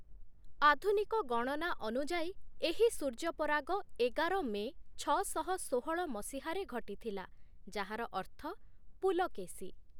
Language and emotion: Odia, neutral